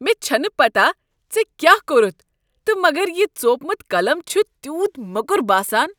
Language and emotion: Kashmiri, disgusted